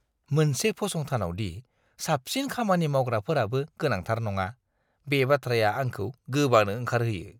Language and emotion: Bodo, disgusted